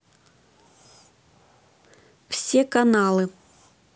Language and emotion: Russian, neutral